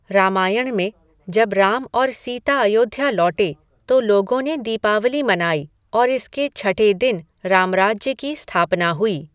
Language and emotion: Hindi, neutral